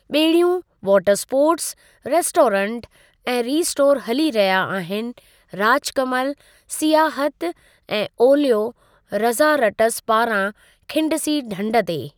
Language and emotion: Sindhi, neutral